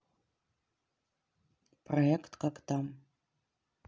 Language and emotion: Russian, neutral